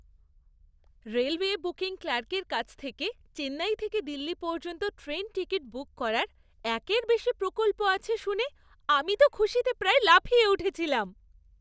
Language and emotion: Bengali, happy